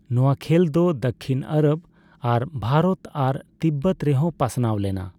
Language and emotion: Santali, neutral